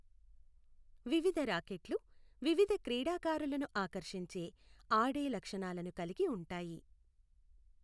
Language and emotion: Telugu, neutral